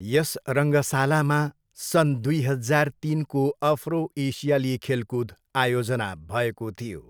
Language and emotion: Nepali, neutral